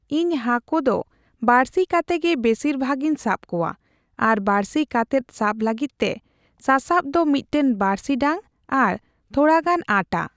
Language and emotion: Santali, neutral